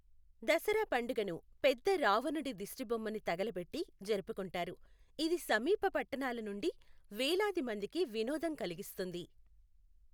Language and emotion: Telugu, neutral